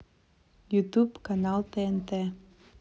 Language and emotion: Russian, neutral